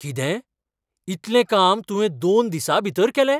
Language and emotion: Goan Konkani, surprised